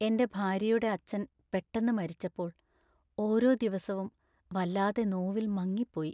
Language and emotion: Malayalam, sad